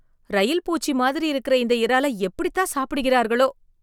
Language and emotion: Tamil, disgusted